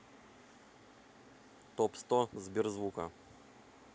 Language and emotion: Russian, neutral